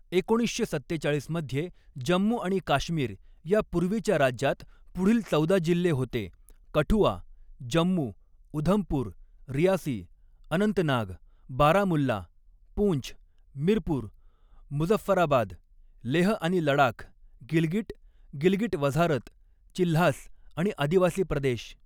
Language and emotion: Marathi, neutral